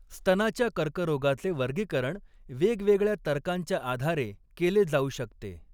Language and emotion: Marathi, neutral